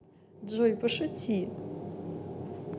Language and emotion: Russian, positive